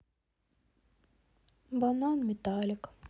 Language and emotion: Russian, sad